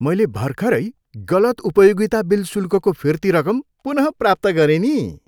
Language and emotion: Nepali, happy